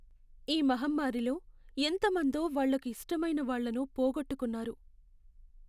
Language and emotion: Telugu, sad